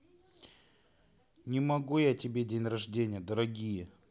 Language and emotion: Russian, neutral